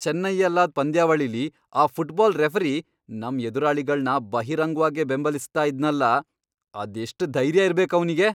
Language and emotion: Kannada, angry